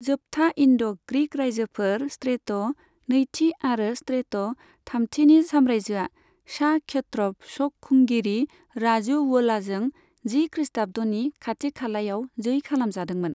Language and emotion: Bodo, neutral